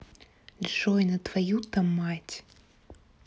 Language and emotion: Russian, angry